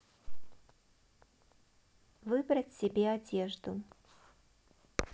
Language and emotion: Russian, neutral